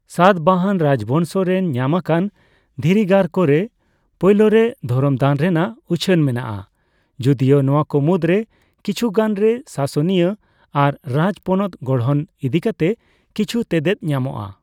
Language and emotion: Santali, neutral